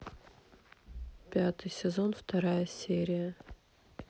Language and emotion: Russian, neutral